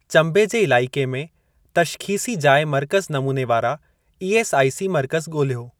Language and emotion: Sindhi, neutral